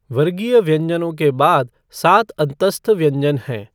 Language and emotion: Hindi, neutral